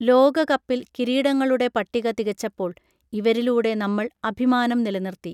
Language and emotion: Malayalam, neutral